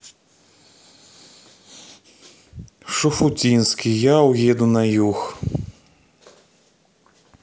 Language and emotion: Russian, neutral